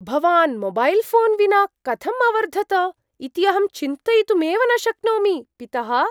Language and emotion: Sanskrit, surprised